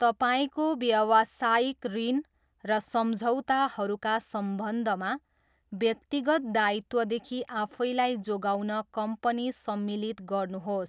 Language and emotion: Nepali, neutral